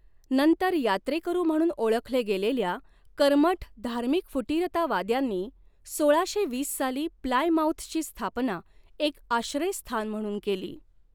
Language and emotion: Marathi, neutral